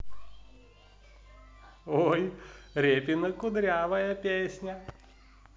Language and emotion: Russian, positive